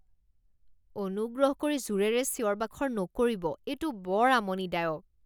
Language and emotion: Assamese, disgusted